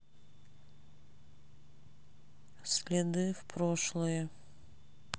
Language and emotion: Russian, neutral